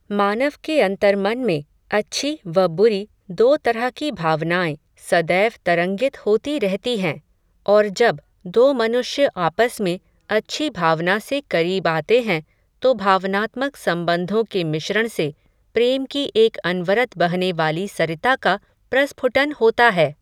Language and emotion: Hindi, neutral